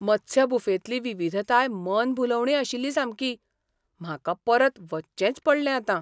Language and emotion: Goan Konkani, surprised